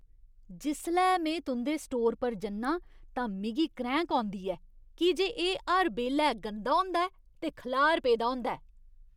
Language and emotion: Dogri, disgusted